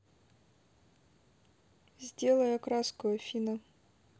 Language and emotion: Russian, neutral